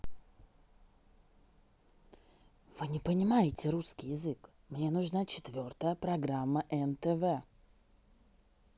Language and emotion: Russian, neutral